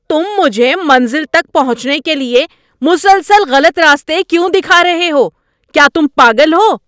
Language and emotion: Urdu, angry